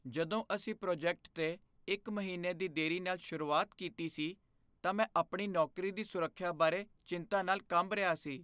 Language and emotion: Punjabi, fearful